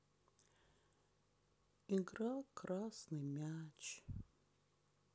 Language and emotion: Russian, sad